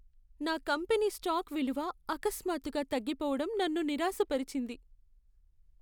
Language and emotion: Telugu, sad